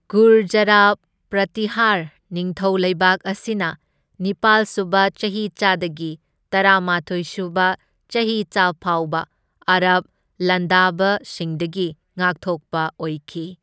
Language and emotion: Manipuri, neutral